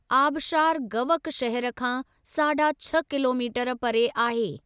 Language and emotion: Sindhi, neutral